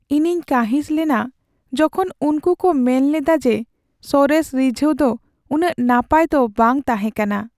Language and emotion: Santali, sad